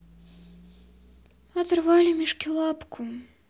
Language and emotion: Russian, sad